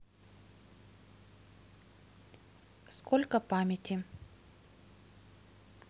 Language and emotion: Russian, neutral